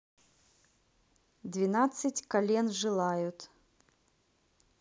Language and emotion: Russian, neutral